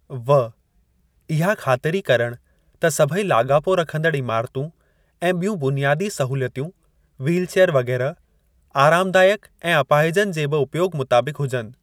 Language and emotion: Sindhi, neutral